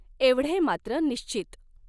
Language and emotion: Marathi, neutral